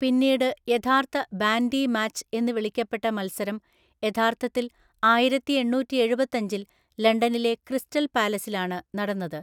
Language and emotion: Malayalam, neutral